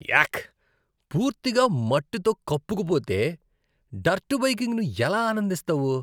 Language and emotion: Telugu, disgusted